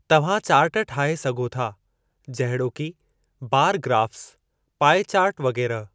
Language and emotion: Sindhi, neutral